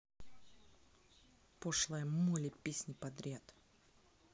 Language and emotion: Russian, angry